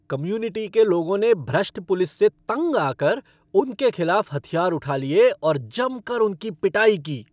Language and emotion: Hindi, angry